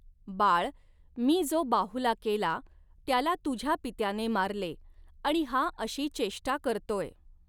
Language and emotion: Marathi, neutral